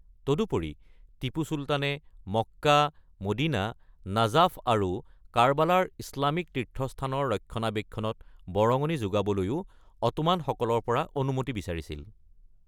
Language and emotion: Assamese, neutral